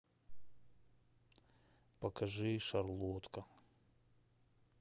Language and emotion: Russian, sad